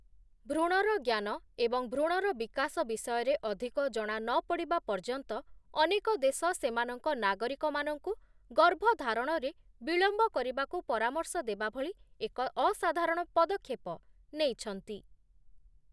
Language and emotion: Odia, neutral